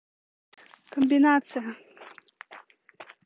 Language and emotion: Russian, neutral